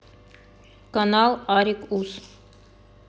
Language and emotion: Russian, neutral